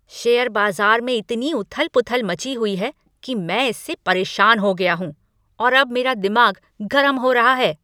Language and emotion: Hindi, angry